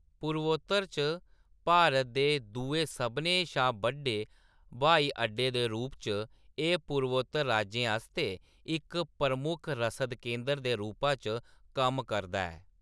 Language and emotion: Dogri, neutral